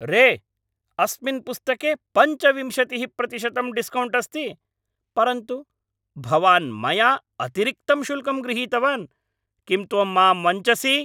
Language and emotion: Sanskrit, angry